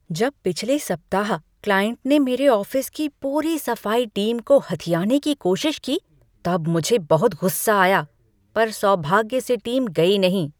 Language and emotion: Hindi, angry